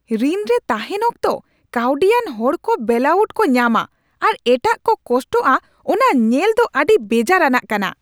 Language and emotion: Santali, angry